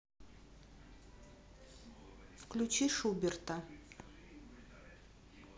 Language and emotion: Russian, neutral